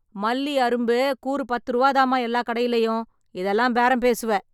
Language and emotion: Tamil, angry